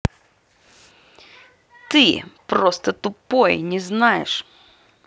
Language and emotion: Russian, angry